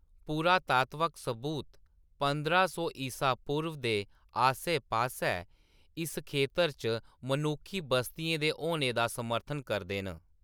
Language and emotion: Dogri, neutral